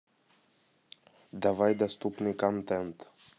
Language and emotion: Russian, neutral